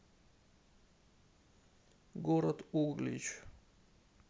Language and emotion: Russian, sad